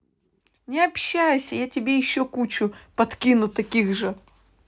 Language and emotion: Russian, neutral